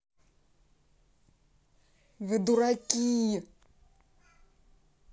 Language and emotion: Russian, angry